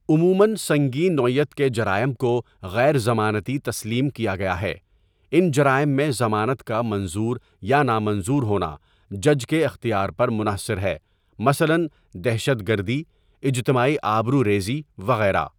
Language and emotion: Urdu, neutral